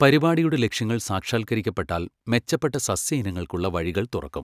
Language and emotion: Malayalam, neutral